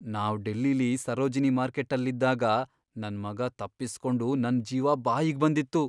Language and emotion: Kannada, fearful